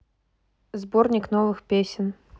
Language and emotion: Russian, neutral